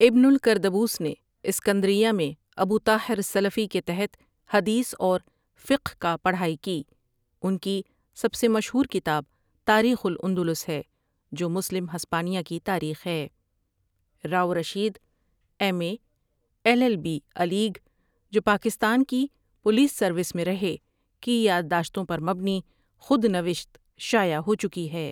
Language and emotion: Urdu, neutral